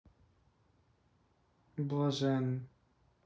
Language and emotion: Russian, neutral